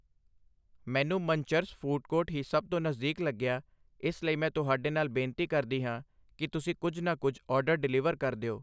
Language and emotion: Punjabi, neutral